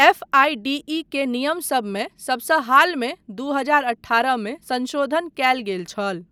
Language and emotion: Maithili, neutral